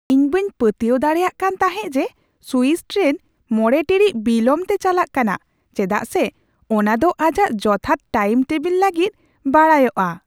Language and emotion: Santali, surprised